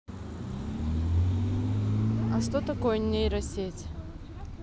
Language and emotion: Russian, neutral